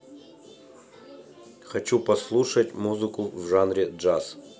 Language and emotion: Russian, neutral